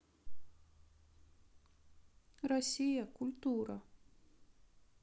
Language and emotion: Russian, sad